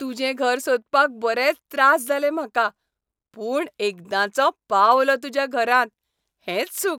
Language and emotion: Goan Konkani, happy